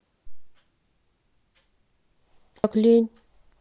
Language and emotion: Russian, sad